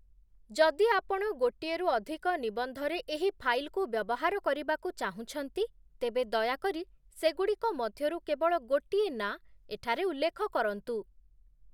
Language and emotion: Odia, neutral